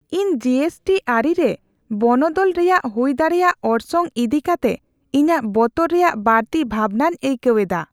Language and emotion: Santali, fearful